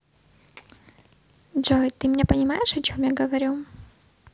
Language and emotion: Russian, neutral